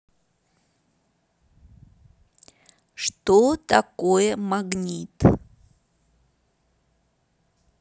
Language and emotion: Russian, neutral